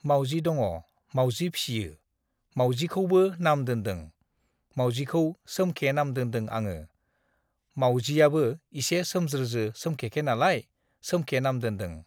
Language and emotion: Bodo, neutral